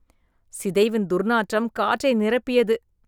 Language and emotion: Tamil, disgusted